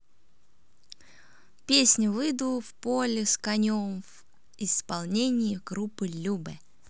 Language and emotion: Russian, positive